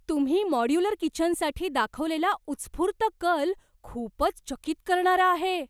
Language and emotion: Marathi, surprised